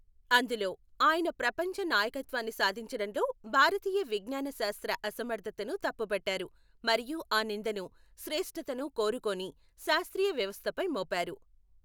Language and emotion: Telugu, neutral